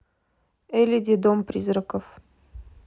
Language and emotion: Russian, neutral